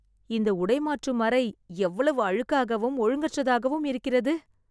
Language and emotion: Tamil, disgusted